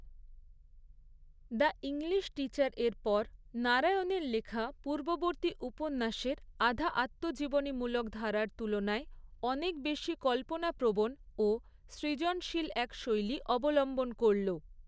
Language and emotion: Bengali, neutral